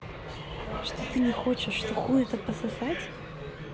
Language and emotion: Russian, neutral